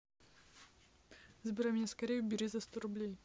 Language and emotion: Russian, neutral